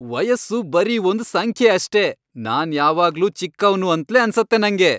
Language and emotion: Kannada, happy